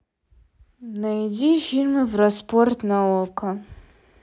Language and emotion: Russian, sad